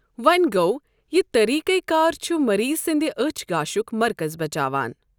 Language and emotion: Kashmiri, neutral